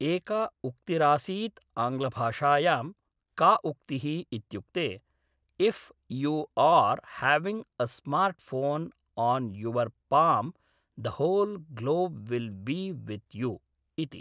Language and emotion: Sanskrit, neutral